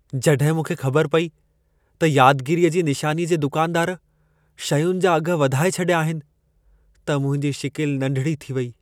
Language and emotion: Sindhi, sad